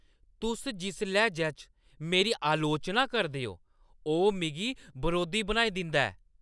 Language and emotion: Dogri, angry